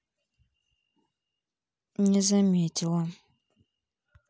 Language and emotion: Russian, neutral